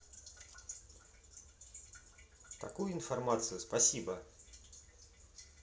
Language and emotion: Russian, neutral